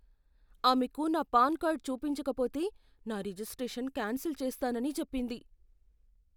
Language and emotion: Telugu, fearful